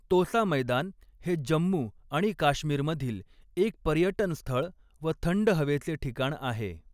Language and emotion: Marathi, neutral